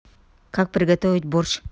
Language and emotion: Russian, neutral